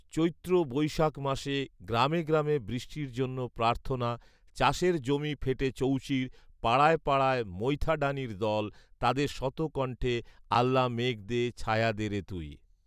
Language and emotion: Bengali, neutral